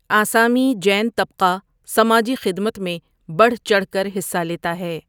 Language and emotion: Urdu, neutral